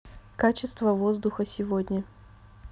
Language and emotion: Russian, neutral